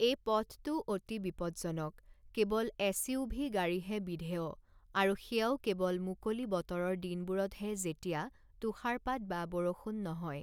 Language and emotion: Assamese, neutral